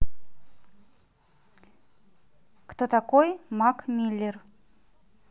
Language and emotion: Russian, neutral